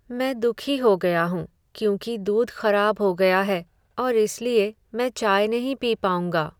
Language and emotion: Hindi, sad